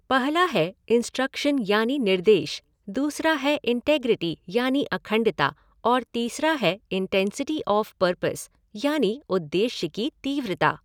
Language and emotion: Hindi, neutral